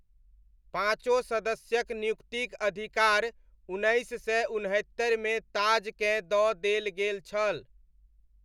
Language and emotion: Maithili, neutral